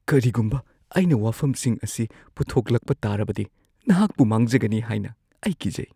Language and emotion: Manipuri, fearful